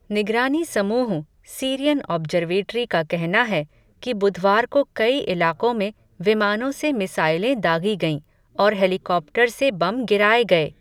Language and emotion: Hindi, neutral